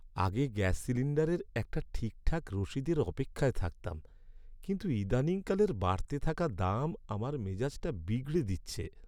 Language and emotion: Bengali, sad